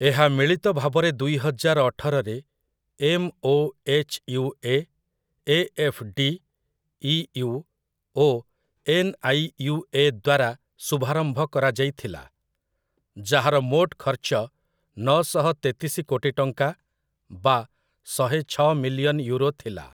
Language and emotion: Odia, neutral